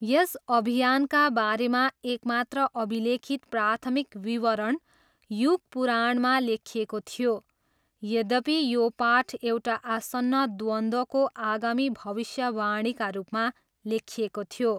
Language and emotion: Nepali, neutral